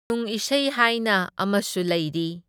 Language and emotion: Manipuri, neutral